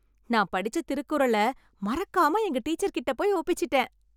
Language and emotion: Tamil, happy